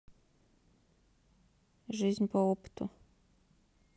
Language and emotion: Russian, neutral